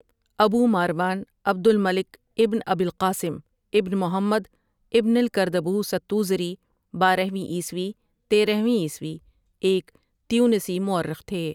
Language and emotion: Urdu, neutral